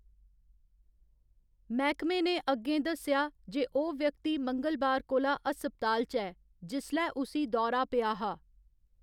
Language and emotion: Dogri, neutral